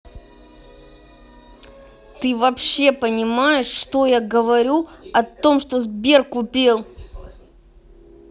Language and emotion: Russian, angry